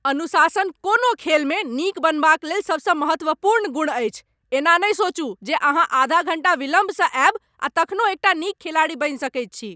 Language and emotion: Maithili, angry